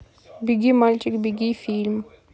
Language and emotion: Russian, neutral